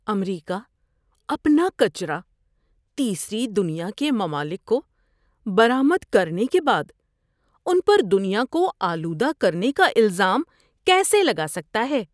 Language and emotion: Urdu, disgusted